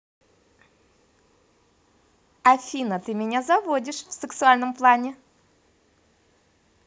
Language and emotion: Russian, positive